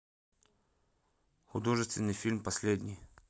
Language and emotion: Russian, neutral